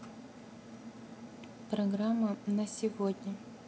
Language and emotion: Russian, neutral